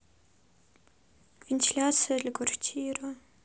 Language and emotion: Russian, sad